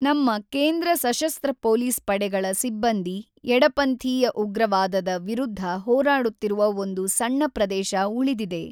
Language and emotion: Kannada, neutral